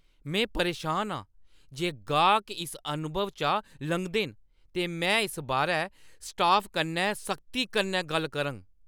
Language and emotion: Dogri, angry